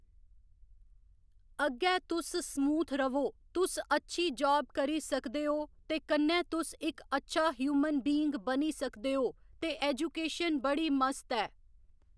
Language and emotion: Dogri, neutral